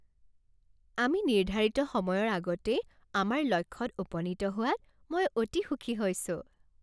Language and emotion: Assamese, happy